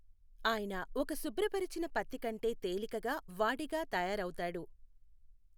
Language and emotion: Telugu, neutral